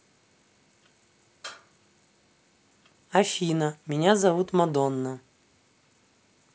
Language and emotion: Russian, neutral